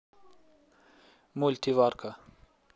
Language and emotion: Russian, neutral